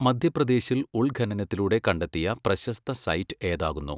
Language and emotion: Malayalam, neutral